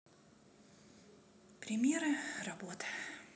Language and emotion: Russian, sad